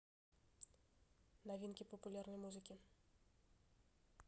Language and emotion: Russian, neutral